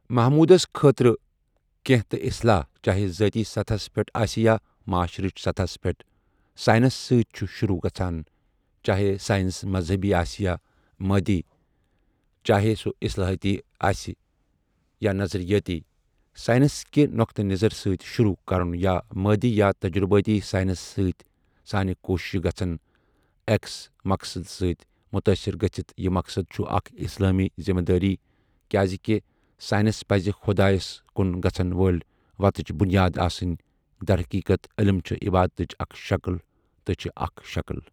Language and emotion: Kashmiri, neutral